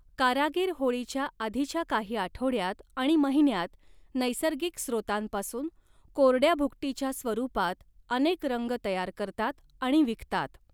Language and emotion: Marathi, neutral